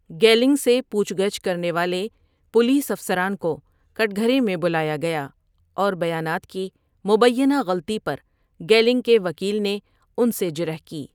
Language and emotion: Urdu, neutral